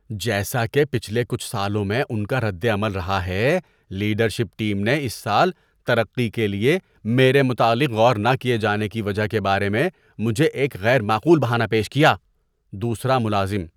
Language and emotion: Urdu, disgusted